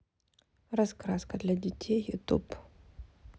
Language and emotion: Russian, neutral